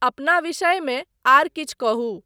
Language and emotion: Maithili, neutral